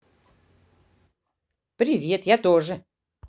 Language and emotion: Russian, positive